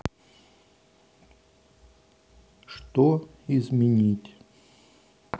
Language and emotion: Russian, neutral